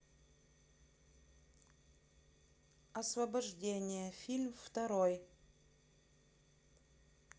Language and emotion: Russian, neutral